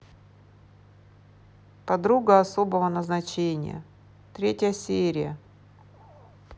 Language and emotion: Russian, neutral